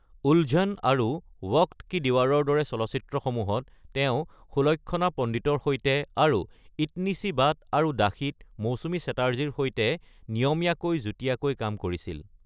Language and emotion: Assamese, neutral